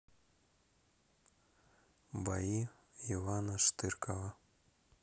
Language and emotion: Russian, neutral